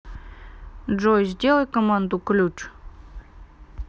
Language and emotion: Russian, neutral